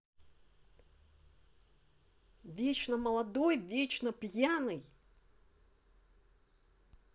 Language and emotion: Russian, angry